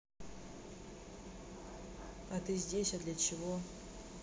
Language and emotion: Russian, neutral